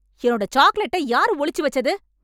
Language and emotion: Tamil, angry